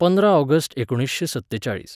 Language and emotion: Goan Konkani, neutral